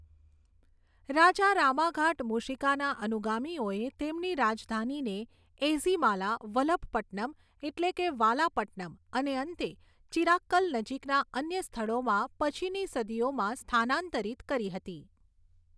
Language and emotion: Gujarati, neutral